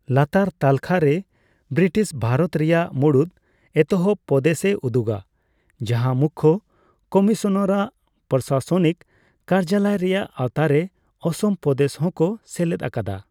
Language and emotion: Santali, neutral